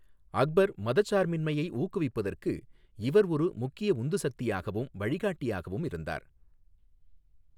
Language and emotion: Tamil, neutral